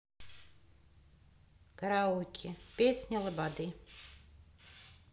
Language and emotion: Russian, neutral